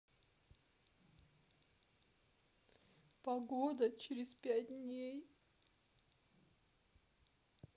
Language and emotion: Russian, sad